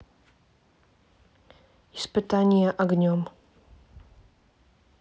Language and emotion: Russian, neutral